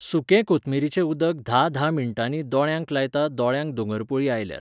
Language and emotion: Goan Konkani, neutral